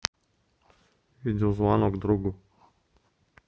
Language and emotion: Russian, neutral